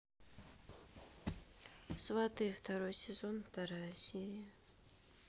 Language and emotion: Russian, sad